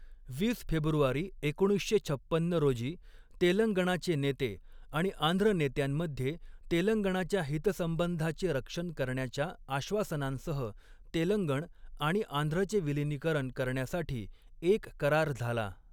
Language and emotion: Marathi, neutral